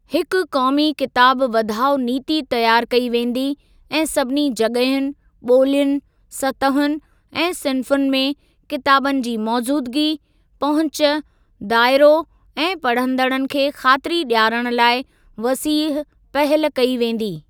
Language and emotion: Sindhi, neutral